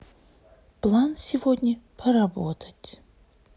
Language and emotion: Russian, sad